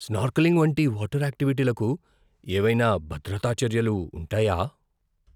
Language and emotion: Telugu, fearful